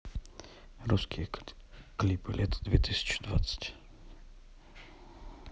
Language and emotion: Russian, neutral